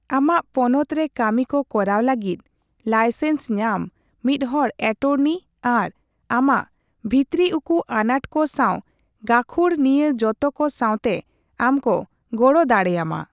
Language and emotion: Santali, neutral